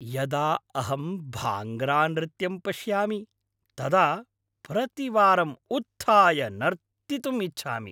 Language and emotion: Sanskrit, happy